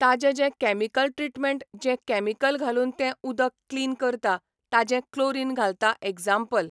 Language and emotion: Goan Konkani, neutral